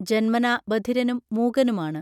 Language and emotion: Malayalam, neutral